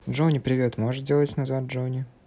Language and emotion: Russian, neutral